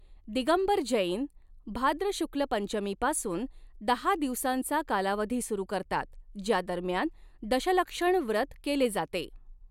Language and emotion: Marathi, neutral